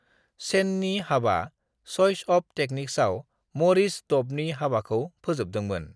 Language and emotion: Bodo, neutral